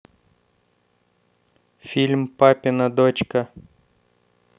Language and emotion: Russian, neutral